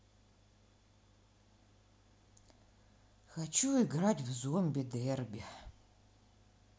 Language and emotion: Russian, sad